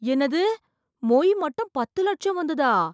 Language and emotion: Tamil, surprised